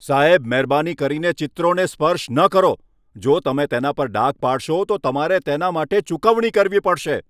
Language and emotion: Gujarati, angry